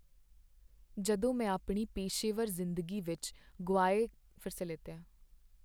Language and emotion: Punjabi, sad